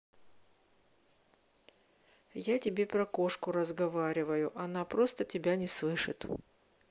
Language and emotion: Russian, neutral